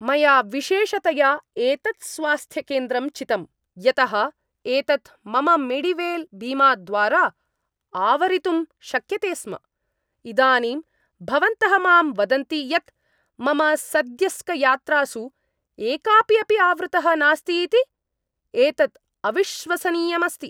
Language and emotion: Sanskrit, angry